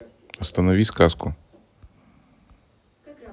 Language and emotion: Russian, neutral